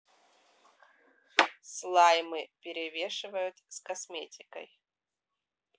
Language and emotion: Russian, neutral